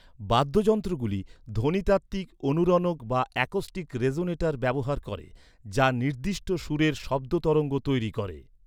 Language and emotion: Bengali, neutral